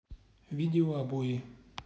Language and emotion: Russian, neutral